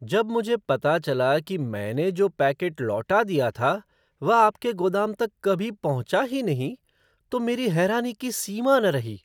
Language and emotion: Hindi, surprised